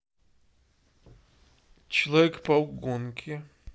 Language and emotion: Russian, neutral